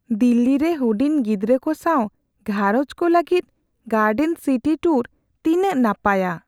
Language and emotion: Santali, fearful